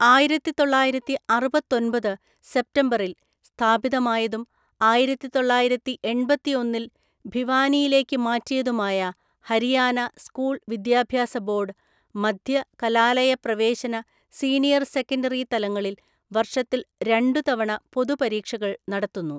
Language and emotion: Malayalam, neutral